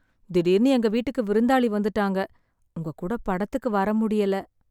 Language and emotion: Tamil, sad